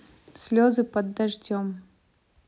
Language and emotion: Russian, neutral